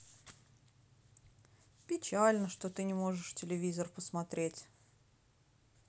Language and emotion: Russian, sad